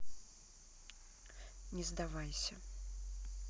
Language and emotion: Russian, neutral